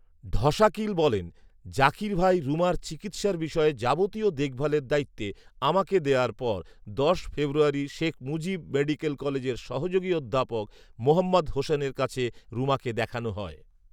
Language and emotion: Bengali, neutral